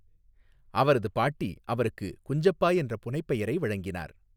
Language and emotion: Tamil, neutral